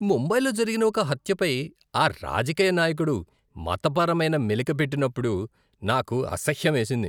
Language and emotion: Telugu, disgusted